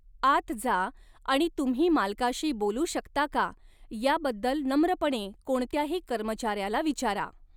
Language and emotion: Marathi, neutral